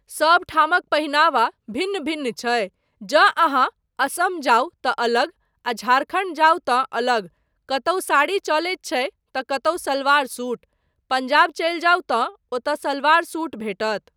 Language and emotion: Maithili, neutral